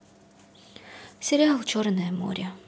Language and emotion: Russian, sad